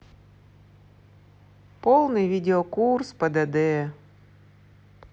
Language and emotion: Russian, sad